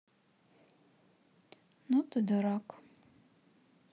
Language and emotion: Russian, sad